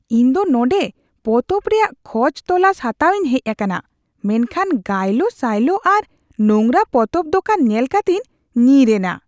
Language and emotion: Santali, disgusted